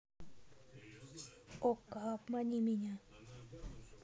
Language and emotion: Russian, neutral